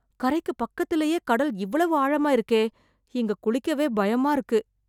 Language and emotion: Tamil, fearful